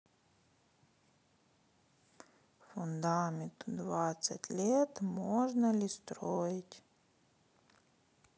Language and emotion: Russian, sad